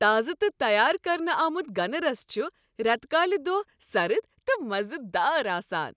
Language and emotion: Kashmiri, happy